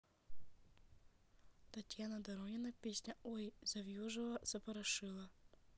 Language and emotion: Russian, neutral